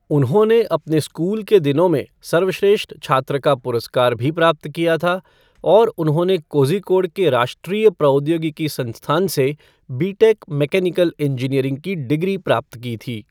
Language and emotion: Hindi, neutral